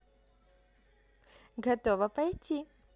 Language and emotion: Russian, positive